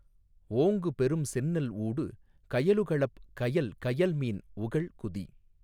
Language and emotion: Tamil, neutral